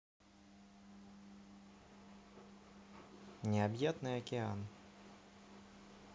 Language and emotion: Russian, neutral